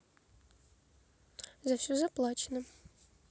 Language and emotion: Russian, neutral